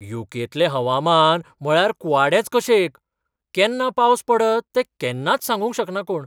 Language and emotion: Goan Konkani, surprised